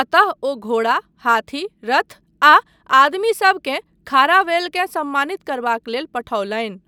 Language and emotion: Maithili, neutral